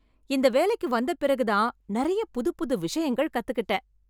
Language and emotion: Tamil, happy